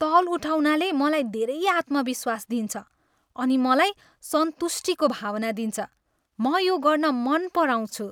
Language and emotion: Nepali, happy